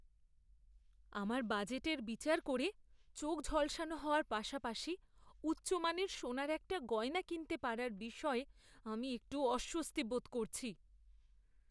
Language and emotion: Bengali, fearful